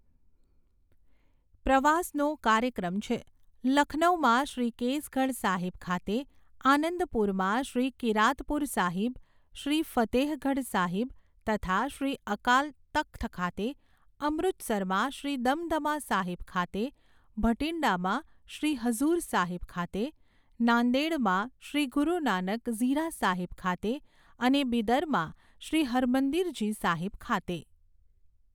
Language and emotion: Gujarati, neutral